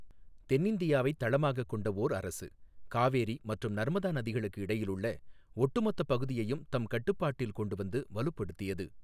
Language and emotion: Tamil, neutral